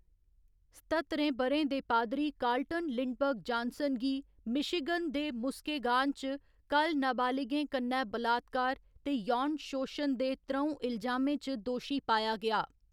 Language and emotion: Dogri, neutral